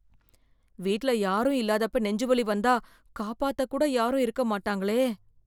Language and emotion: Tamil, fearful